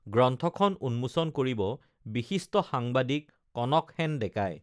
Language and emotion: Assamese, neutral